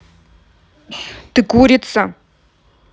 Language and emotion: Russian, neutral